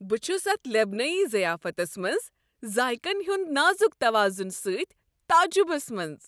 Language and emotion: Kashmiri, happy